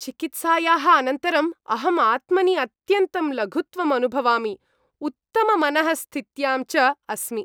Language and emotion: Sanskrit, happy